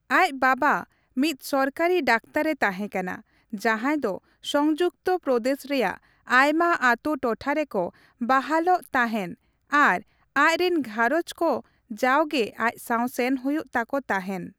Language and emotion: Santali, neutral